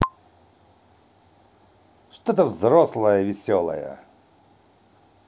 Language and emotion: Russian, positive